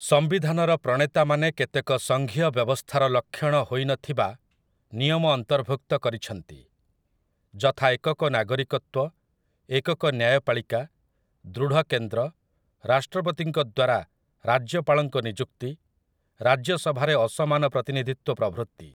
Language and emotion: Odia, neutral